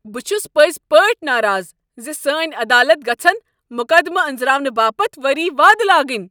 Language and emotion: Kashmiri, angry